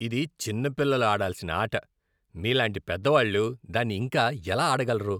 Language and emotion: Telugu, disgusted